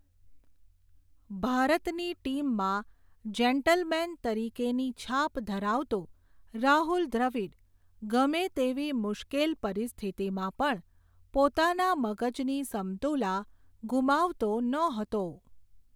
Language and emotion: Gujarati, neutral